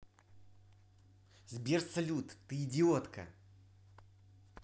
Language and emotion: Russian, angry